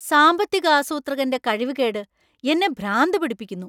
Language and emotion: Malayalam, angry